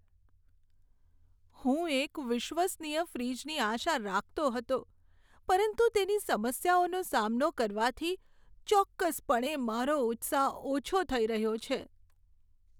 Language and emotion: Gujarati, sad